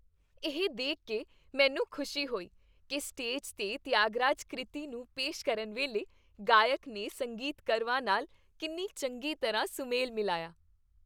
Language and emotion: Punjabi, happy